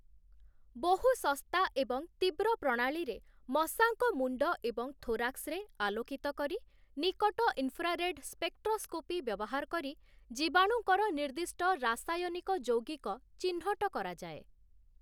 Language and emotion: Odia, neutral